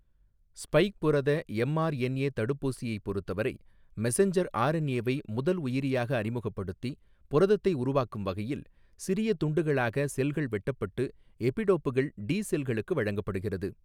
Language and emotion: Tamil, neutral